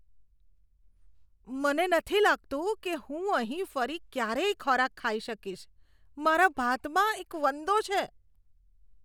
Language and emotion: Gujarati, disgusted